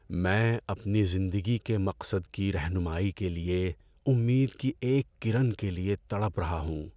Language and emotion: Urdu, sad